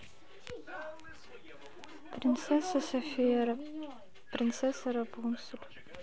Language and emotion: Russian, sad